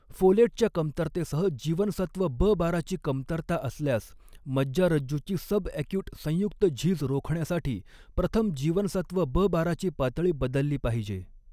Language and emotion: Marathi, neutral